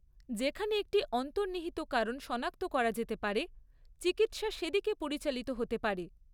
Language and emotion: Bengali, neutral